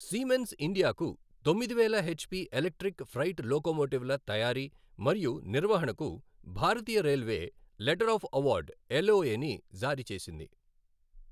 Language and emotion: Telugu, neutral